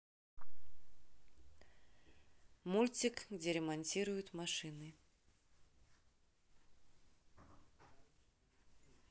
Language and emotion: Russian, neutral